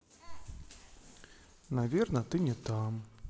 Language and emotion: Russian, sad